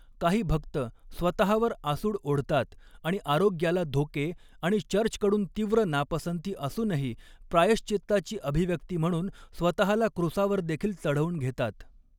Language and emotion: Marathi, neutral